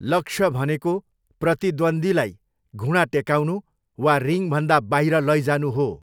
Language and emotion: Nepali, neutral